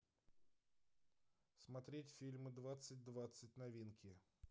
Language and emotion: Russian, neutral